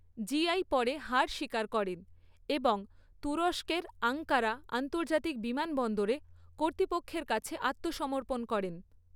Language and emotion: Bengali, neutral